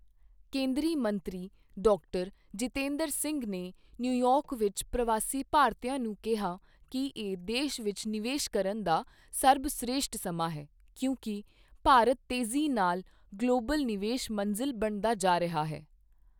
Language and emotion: Punjabi, neutral